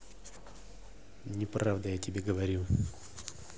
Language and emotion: Russian, angry